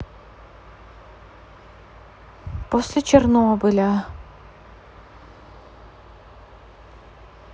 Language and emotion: Russian, sad